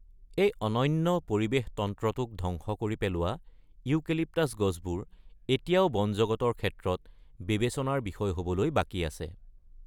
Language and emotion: Assamese, neutral